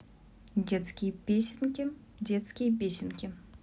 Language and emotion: Russian, neutral